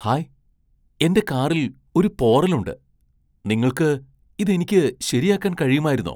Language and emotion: Malayalam, surprised